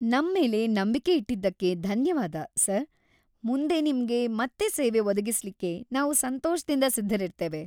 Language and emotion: Kannada, happy